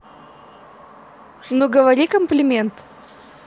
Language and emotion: Russian, positive